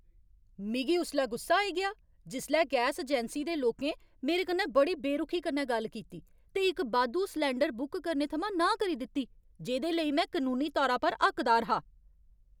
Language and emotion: Dogri, angry